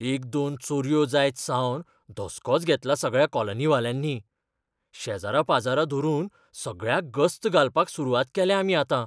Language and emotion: Goan Konkani, fearful